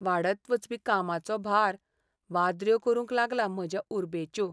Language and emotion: Goan Konkani, sad